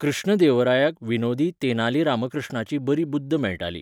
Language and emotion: Goan Konkani, neutral